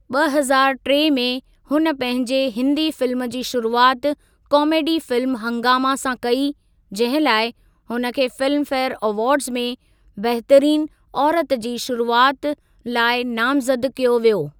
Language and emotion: Sindhi, neutral